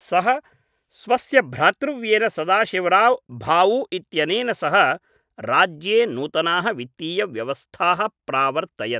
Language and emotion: Sanskrit, neutral